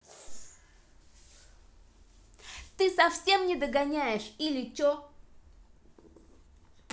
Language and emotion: Russian, angry